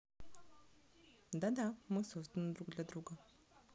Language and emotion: Russian, neutral